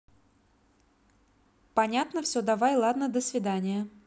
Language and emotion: Russian, neutral